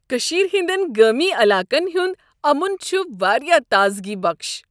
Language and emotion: Kashmiri, happy